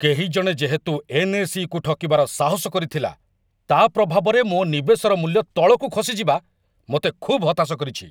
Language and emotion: Odia, angry